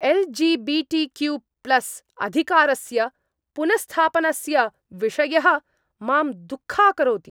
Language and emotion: Sanskrit, angry